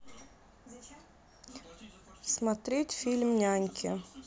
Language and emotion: Russian, neutral